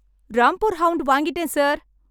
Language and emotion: Tamil, happy